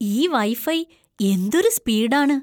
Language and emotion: Malayalam, surprised